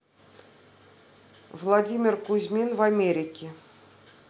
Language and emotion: Russian, neutral